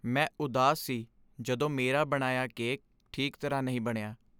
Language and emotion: Punjabi, sad